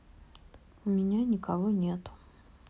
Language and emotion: Russian, sad